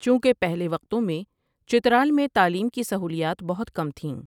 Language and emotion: Urdu, neutral